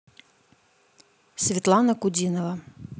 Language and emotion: Russian, neutral